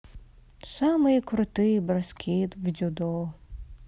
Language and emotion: Russian, sad